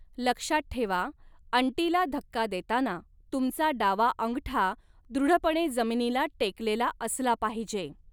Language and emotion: Marathi, neutral